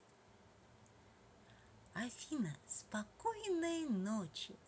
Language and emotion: Russian, positive